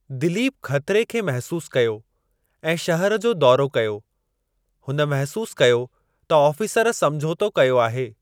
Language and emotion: Sindhi, neutral